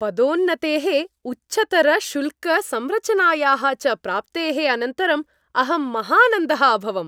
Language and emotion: Sanskrit, happy